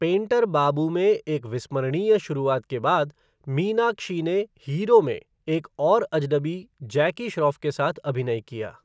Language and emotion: Hindi, neutral